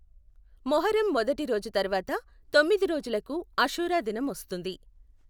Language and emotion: Telugu, neutral